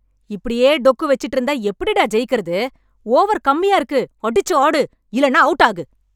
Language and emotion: Tamil, angry